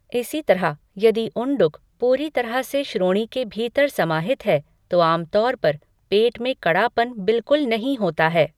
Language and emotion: Hindi, neutral